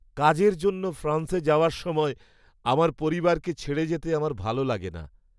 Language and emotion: Bengali, sad